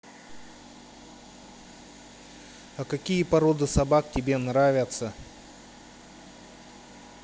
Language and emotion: Russian, neutral